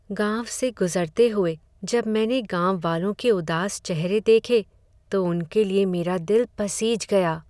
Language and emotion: Hindi, sad